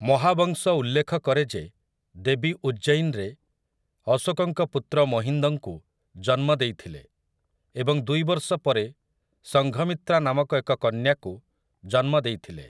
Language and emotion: Odia, neutral